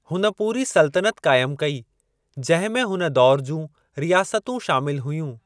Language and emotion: Sindhi, neutral